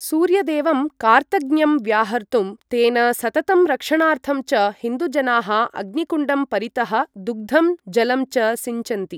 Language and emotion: Sanskrit, neutral